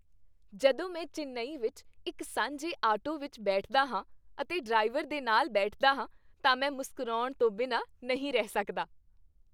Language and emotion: Punjabi, happy